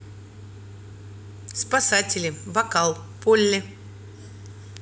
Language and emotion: Russian, neutral